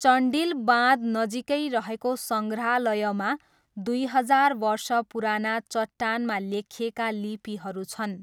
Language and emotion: Nepali, neutral